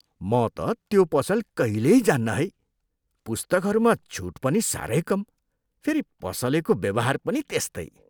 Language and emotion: Nepali, disgusted